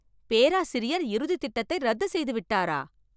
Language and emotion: Tamil, surprised